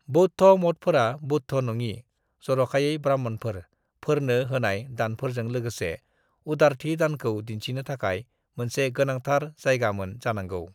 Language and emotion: Bodo, neutral